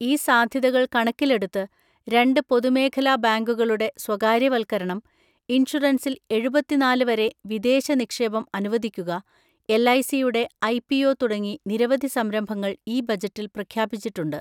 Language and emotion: Malayalam, neutral